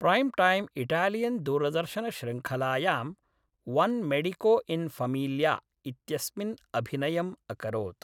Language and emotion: Sanskrit, neutral